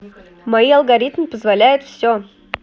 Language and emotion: Russian, neutral